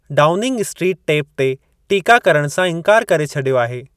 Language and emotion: Sindhi, neutral